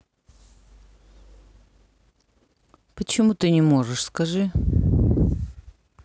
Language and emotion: Russian, neutral